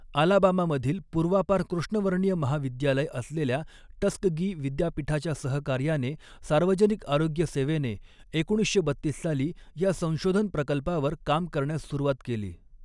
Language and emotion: Marathi, neutral